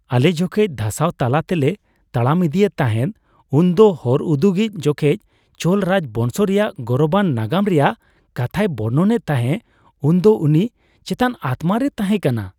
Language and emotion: Santali, happy